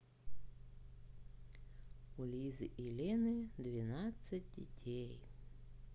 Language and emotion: Russian, neutral